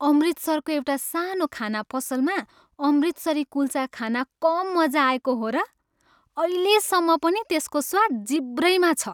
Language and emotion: Nepali, happy